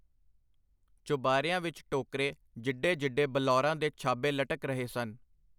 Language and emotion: Punjabi, neutral